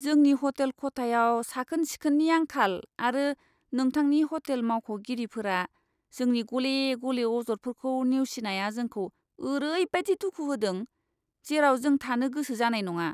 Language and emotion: Bodo, disgusted